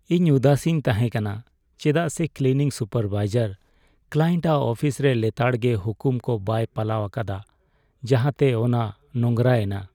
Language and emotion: Santali, sad